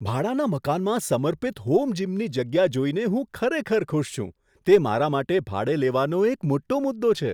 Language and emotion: Gujarati, surprised